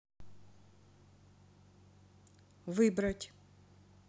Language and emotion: Russian, neutral